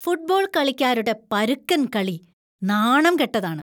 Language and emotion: Malayalam, disgusted